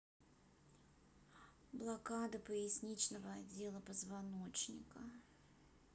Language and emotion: Russian, neutral